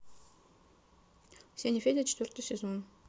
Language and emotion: Russian, neutral